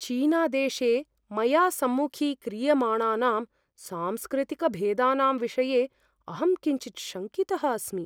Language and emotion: Sanskrit, fearful